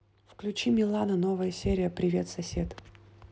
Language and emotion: Russian, neutral